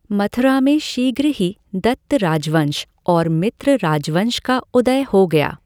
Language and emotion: Hindi, neutral